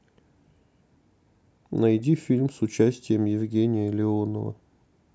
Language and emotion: Russian, neutral